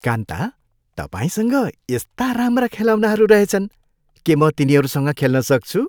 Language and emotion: Nepali, happy